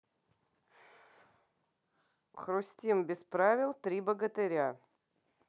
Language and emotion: Russian, neutral